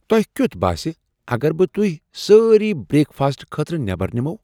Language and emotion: Kashmiri, surprised